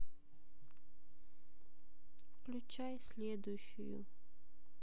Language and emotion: Russian, sad